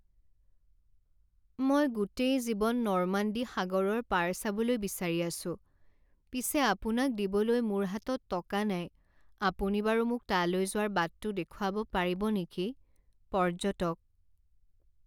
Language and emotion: Assamese, sad